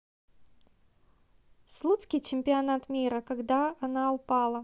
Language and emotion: Russian, neutral